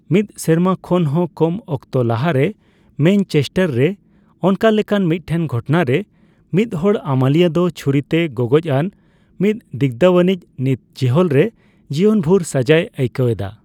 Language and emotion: Santali, neutral